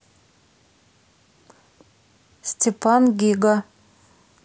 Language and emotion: Russian, neutral